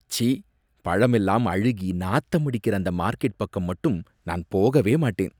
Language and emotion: Tamil, disgusted